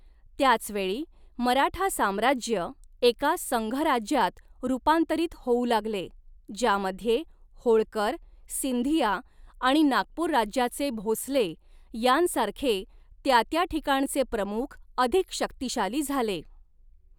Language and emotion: Marathi, neutral